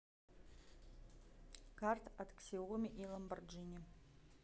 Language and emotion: Russian, neutral